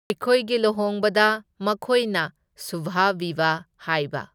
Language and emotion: Manipuri, neutral